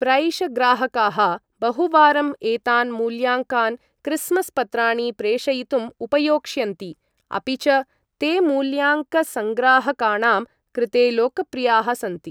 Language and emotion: Sanskrit, neutral